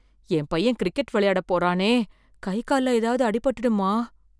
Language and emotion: Tamil, fearful